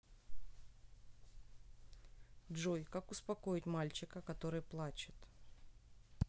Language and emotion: Russian, neutral